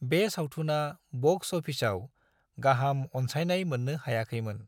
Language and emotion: Bodo, neutral